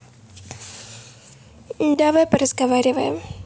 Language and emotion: Russian, neutral